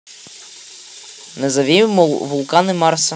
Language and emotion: Russian, neutral